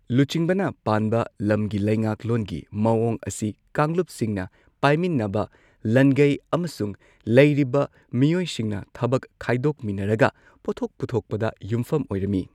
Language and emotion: Manipuri, neutral